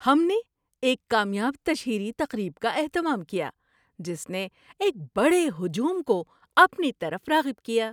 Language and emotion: Urdu, happy